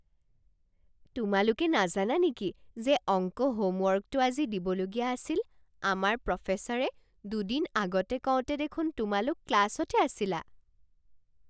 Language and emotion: Assamese, surprised